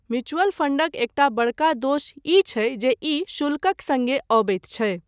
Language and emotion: Maithili, neutral